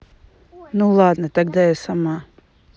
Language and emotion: Russian, neutral